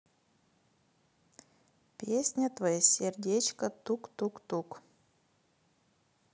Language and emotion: Russian, neutral